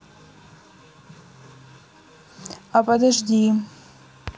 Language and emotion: Russian, neutral